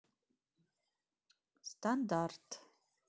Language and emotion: Russian, neutral